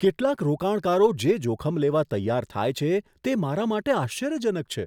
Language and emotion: Gujarati, surprised